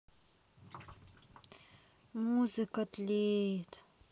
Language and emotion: Russian, sad